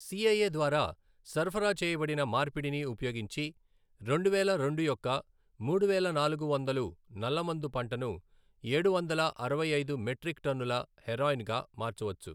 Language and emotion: Telugu, neutral